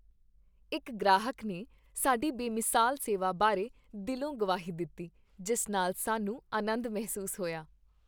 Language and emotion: Punjabi, happy